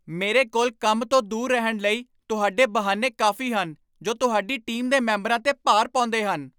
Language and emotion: Punjabi, angry